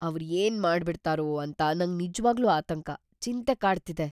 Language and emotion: Kannada, fearful